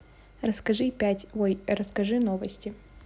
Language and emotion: Russian, neutral